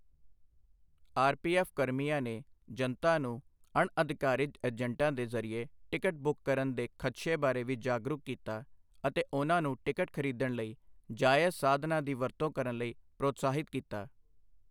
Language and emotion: Punjabi, neutral